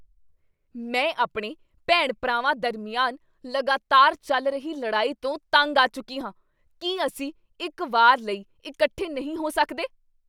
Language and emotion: Punjabi, angry